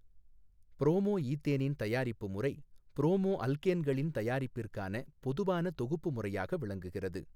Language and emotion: Tamil, neutral